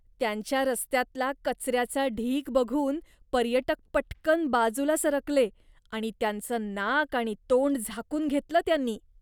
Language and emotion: Marathi, disgusted